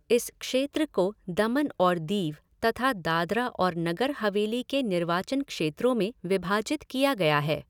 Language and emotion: Hindi, neutral